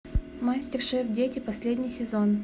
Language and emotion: Russian, neutral